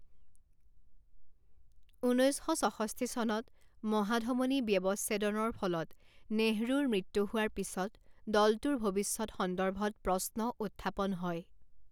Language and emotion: Assamese, neutral